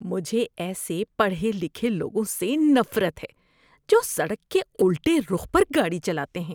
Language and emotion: Urdu, disgusted